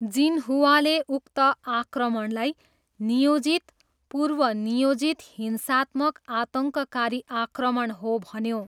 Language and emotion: Nepali, neutral